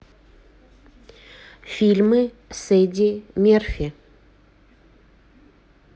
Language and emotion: Russian, neutral